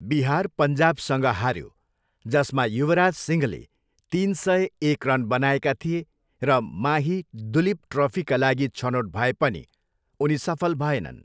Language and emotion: Nepali, neutral